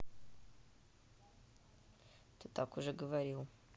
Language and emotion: Russian, neutral